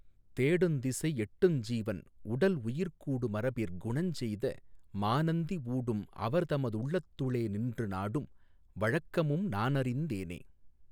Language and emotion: Tamil, neutral